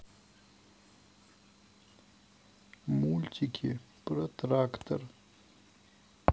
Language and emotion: Russian, sad